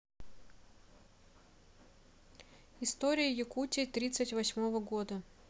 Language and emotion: Russian, neutral